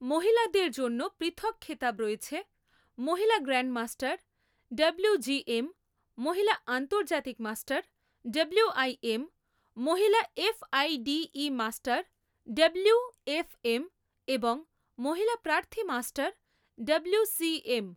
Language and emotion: Bengali, neutral